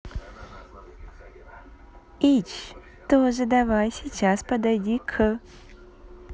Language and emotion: Russian, positive